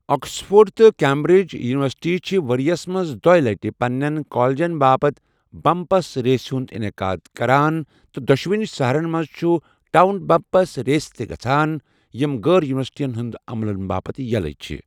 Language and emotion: Kashmiri, neutral